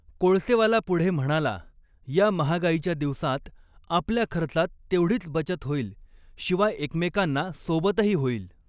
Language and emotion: Marathi, neutral